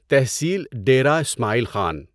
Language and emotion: Urdu, neutral